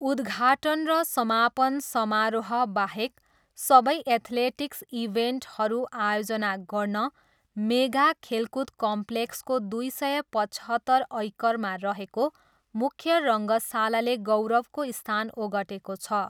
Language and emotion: Nepali, neutral